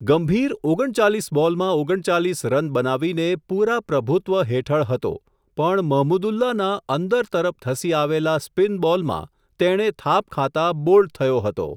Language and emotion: Gujarati, neutral